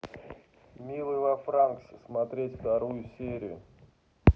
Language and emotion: Russian, neutral